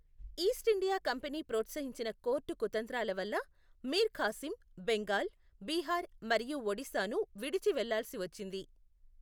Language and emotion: Telugu, neutral